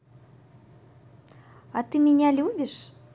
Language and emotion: Russian, positive